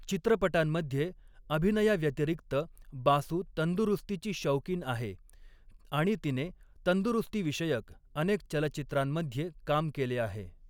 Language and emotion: Marathi, neutral